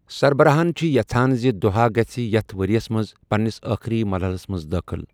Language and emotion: Kashmiri, neutral